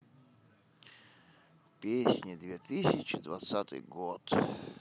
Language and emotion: Russian, sad